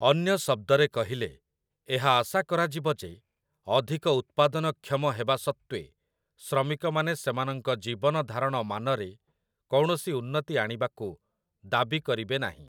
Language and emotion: Odia, neutral